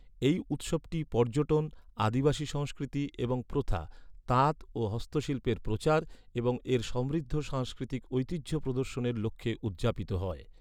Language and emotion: Bengali, neutral